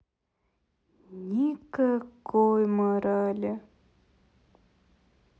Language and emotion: Russian, sad